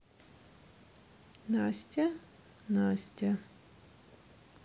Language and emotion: Russian, neutral